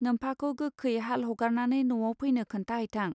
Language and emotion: Bodo, neutral